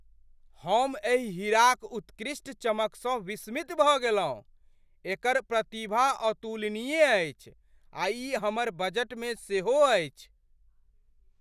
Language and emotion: Maithili, surprised